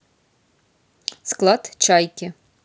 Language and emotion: Russian, neutral